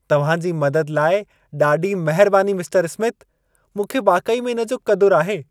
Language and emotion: Sindhi, happy